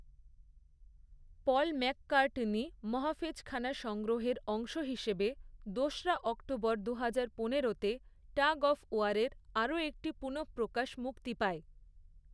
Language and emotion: Bengali, neutral